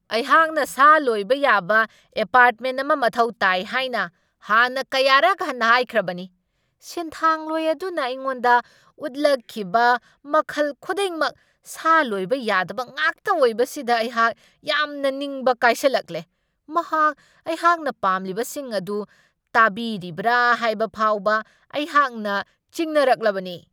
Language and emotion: Manipuri, angry